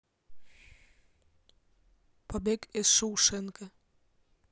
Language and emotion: Russian, neutral